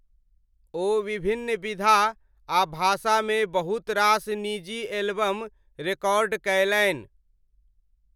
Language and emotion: Maithili, neutral